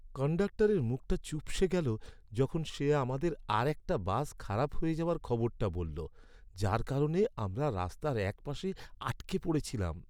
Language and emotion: Bengali, sad